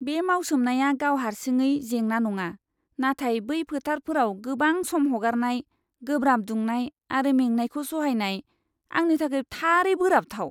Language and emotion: Bodo, disgusted